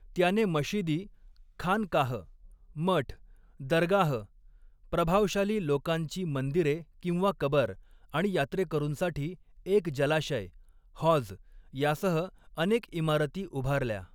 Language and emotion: Marathi, neutral